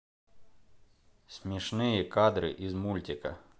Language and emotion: Russian, neutral